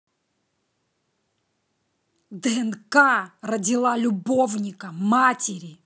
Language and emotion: Russian, angry